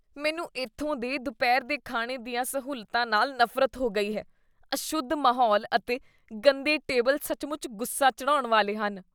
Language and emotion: Punjabi, disgusted